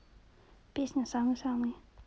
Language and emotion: Russian, neutral